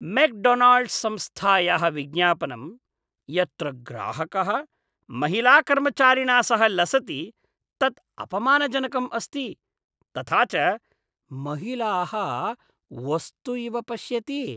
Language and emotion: Sanskrit, disgusted